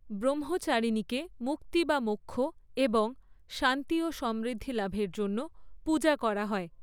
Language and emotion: Bengali, neutral